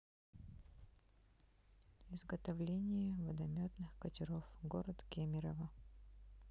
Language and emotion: Russian, neutral